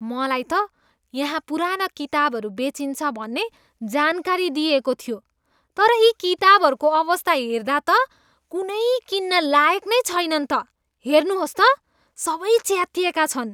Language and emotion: Nepali, disgusted